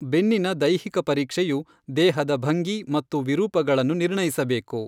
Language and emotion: Kannada, neutral